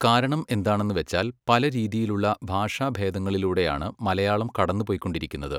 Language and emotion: Malayalam, neutral